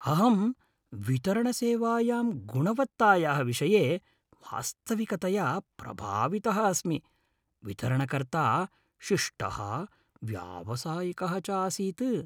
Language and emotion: Sanskrit, happy